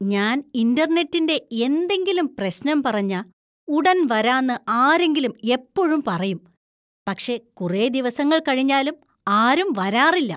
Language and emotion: Malayalam, disgusted